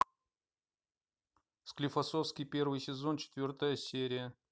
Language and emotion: Russian, neutral